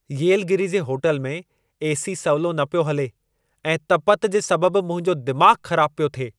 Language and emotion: Sindhi, angry